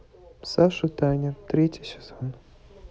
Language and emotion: Russian, neutral